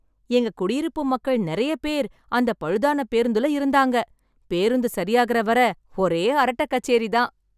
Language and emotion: Tamil, happy